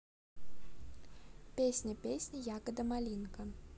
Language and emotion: Russian, neutral